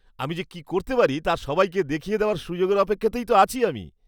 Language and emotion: Bengali, happy